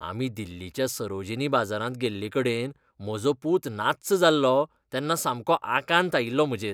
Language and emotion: Goan Konkani, disgusted